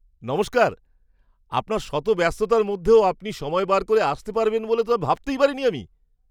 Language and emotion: Bengali, surprised